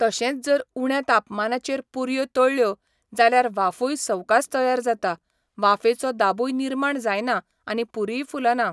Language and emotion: Goan Konkani, neutral